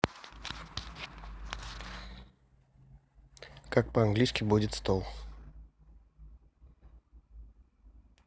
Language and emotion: Russian, neutral